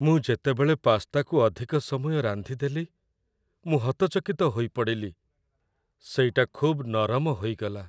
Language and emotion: Odia, sad